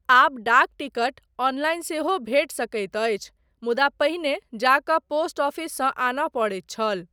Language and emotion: Maithili, neutral